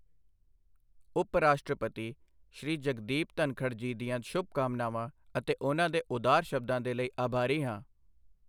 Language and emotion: Punjabi, neutral